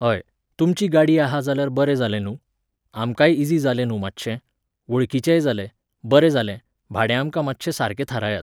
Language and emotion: Goan Konkani, neutral